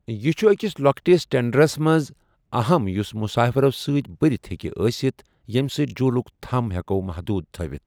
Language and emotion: Kashmiri, neutral